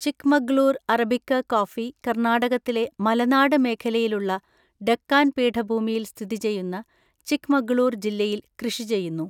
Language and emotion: Malayalam, neutral